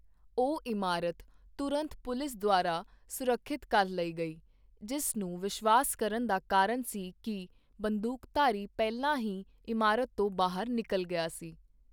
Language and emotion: Punjabi, neutral